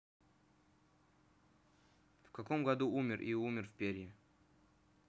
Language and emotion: Russian, neutral